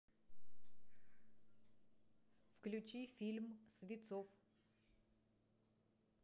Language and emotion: Russian, neutral